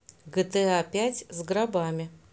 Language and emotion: Russian, neutral